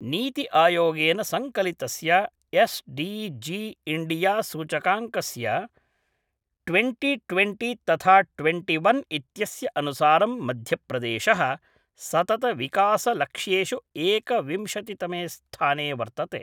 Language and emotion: Sanskrit, neutral